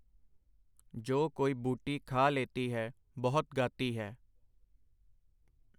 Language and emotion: Punjabi, neutral